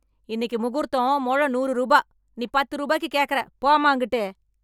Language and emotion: Tamil, angry